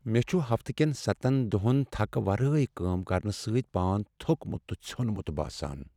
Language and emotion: Kashmiri, sad